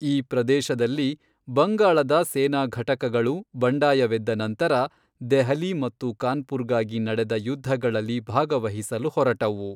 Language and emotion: Kannada, neutral